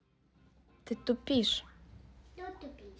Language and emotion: Russian, neutral